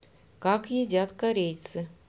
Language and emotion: Russian, neutral